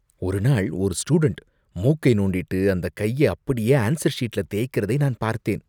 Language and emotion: Tamil, disgusted